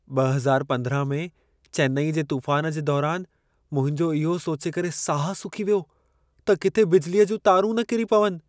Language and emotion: Sindhi, fearful